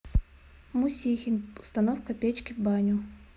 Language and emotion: Russian, neutral